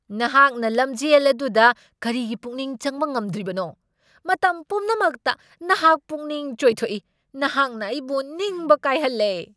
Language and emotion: Manipuri, angry